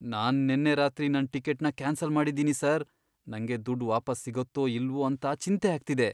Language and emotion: Kannada, fearful